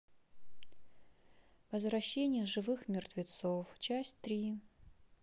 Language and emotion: Russian, sad